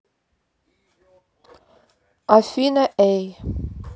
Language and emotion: Russian, neutral